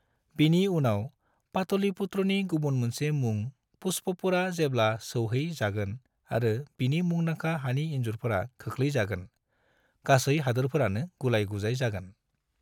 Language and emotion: Bodo, neutral